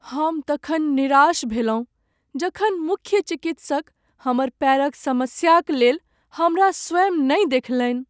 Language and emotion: Maithili, sad